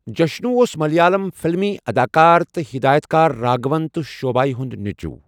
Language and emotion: Kashmiri, neutral